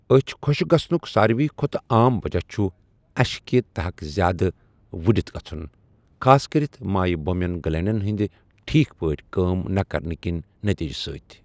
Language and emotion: Kashmiri, neutral